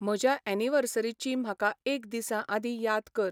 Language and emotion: Goan Konkani, neutral